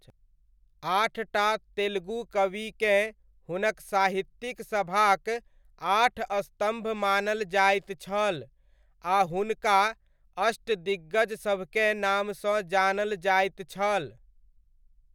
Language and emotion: Maithili, neutral